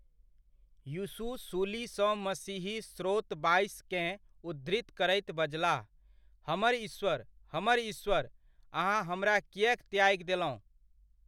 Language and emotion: Maithili, neutral